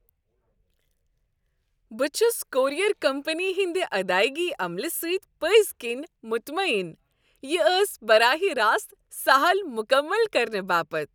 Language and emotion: Kashmiri, happy